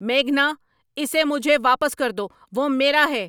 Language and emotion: Urdu, angry